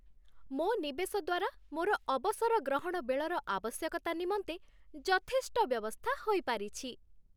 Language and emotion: Odia, happy